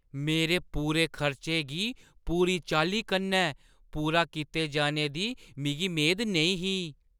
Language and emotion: Dogri, surprised